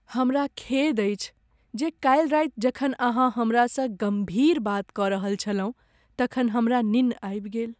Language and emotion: Maithili, sad